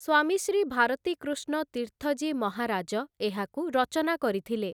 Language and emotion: Odia, neutral